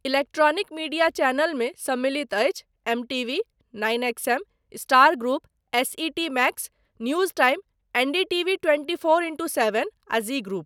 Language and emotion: Maithili, neutral